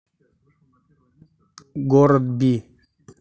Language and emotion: Russian, neutral